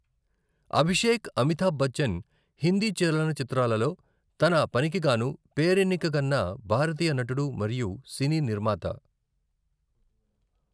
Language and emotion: Telugu, neutral